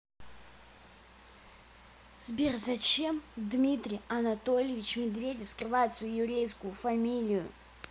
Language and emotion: Russian, angry